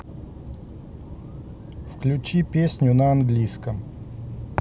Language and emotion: Russian, neutral